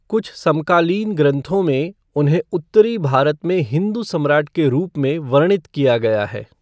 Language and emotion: Hindi, neutral